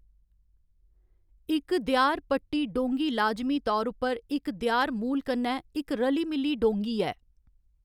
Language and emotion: Dogri, neutral